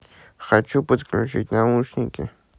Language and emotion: Russian, neutral